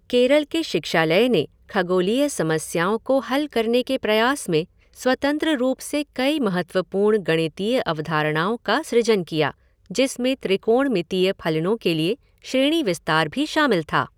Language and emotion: Hindi, neutral